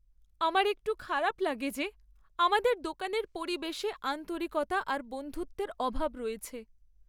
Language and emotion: Bengali, sad